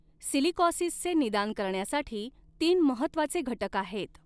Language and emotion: Marathi, neutral